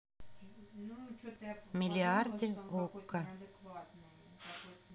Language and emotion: Russian, neutral